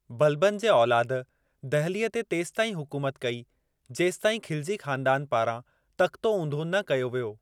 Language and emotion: Sindhi, neutral